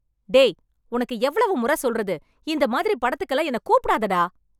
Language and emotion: Tamil, angry